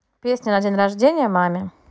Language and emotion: Russian, neutral